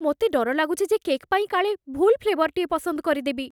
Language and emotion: Odia, fearful